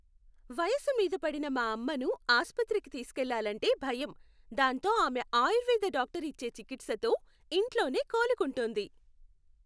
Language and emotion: Telugu, happy